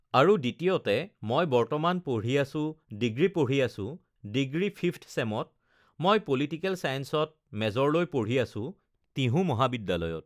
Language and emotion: Assamese, neutral